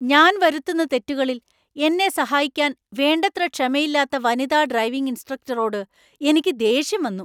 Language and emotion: Malayalam, angry